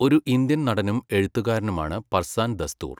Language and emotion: Malayalam, neutral